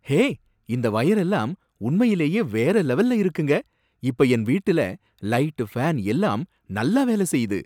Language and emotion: Tamil, surprised